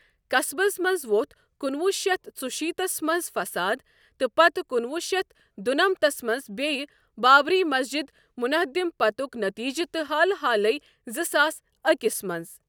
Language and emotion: Kashmiri, neutral